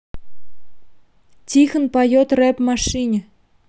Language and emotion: Russian, neutral